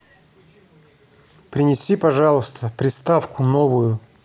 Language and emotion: Russian, neutral